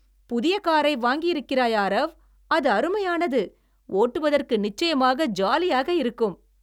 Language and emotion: Tamil, happy